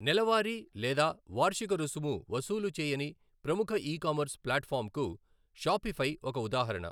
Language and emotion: Telugu, neutral